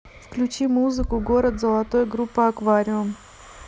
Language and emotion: Russian, neutral